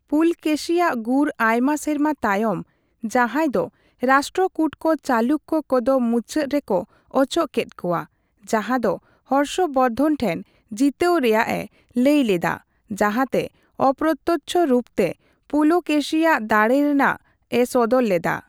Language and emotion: Santali, neutral